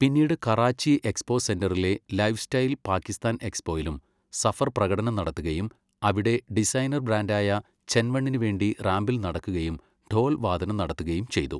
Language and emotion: Malayalam, neutral